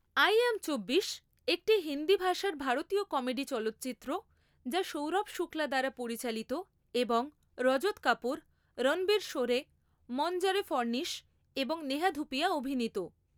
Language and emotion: Bengali, neutral